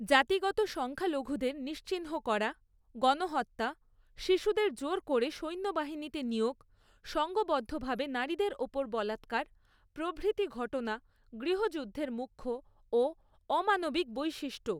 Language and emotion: Bengali, neutral